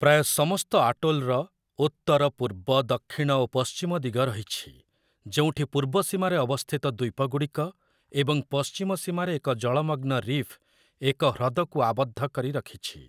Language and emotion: Odia, neutral